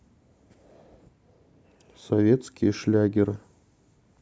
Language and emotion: Russian, neutral